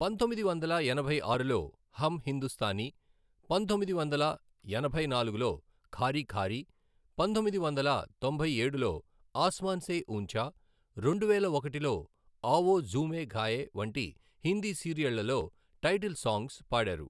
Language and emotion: Telugu, neutral